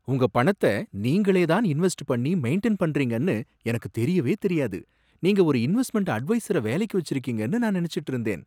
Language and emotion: Tamil, surprised